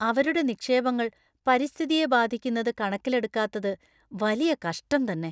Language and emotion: Malayalam, disgusted